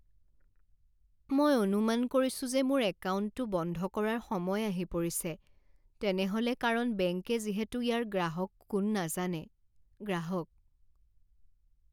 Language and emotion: Assamese, sad